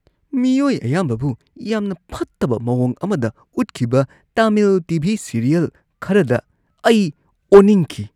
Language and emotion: Manipuri, disgusted